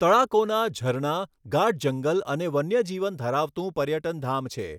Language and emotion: Gujarati, neutral